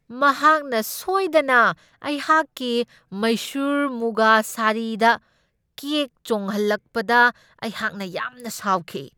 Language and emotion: Manipuri, angry